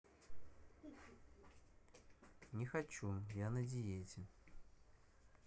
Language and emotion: Russian, neutral